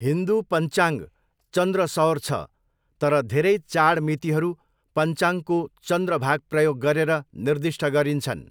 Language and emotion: Nepali, neutral